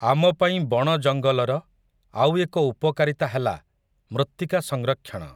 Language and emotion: Odia, neutral